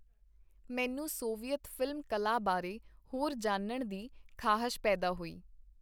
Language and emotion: Punjabi, neutral